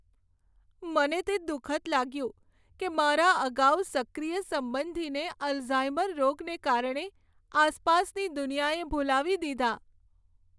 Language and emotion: Gujarati, sad